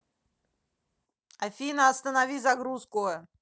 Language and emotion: Russian, angry